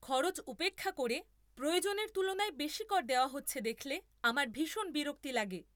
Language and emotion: Bengali, angry